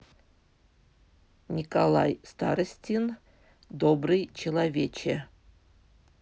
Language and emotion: Russian, neutral